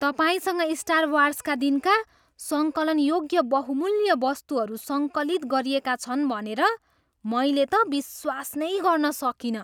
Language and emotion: Nepali, surprised